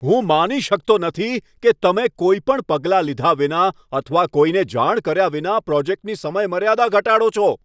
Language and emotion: Gujarati, angry